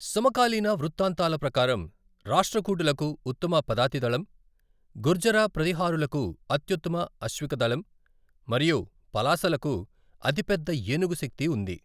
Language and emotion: Telugu, neutral